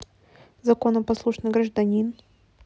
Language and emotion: Russian, neutral